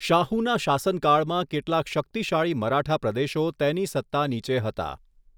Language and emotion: Gujarati, neutral